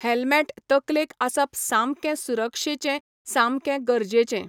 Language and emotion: Goan Konkani, neutral